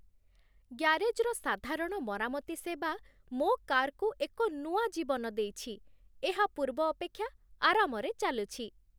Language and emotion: Odia, happy